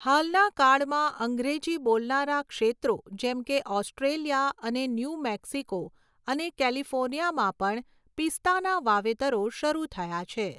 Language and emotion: Gujarati, neutral